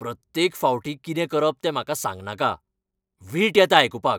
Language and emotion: Goan Konkani, angry